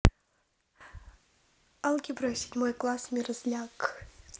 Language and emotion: Russian, neutral